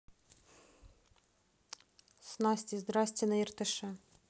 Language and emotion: Russian, neutral